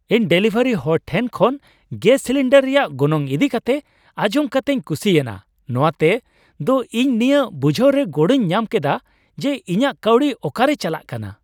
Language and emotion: Santali, happy